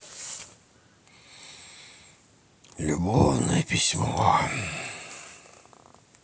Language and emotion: Russian, sad